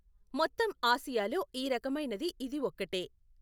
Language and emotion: Telugu, neutral